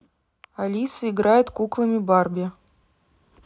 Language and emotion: Russian, neutral